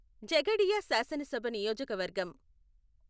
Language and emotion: Telugu, neutral